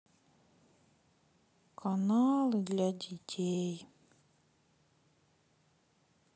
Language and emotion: Russian, sad